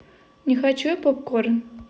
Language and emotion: Russian, neutral